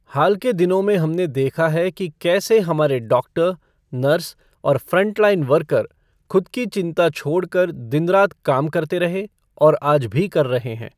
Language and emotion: Hindi, neutral